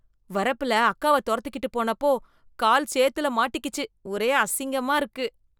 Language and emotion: Tamil, disgusted